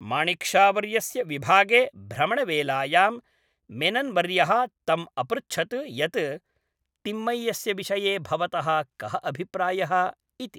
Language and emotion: Sanskrit, neutral